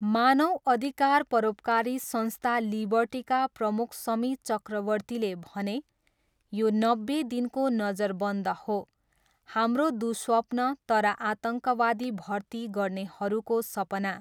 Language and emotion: Nepali, neutral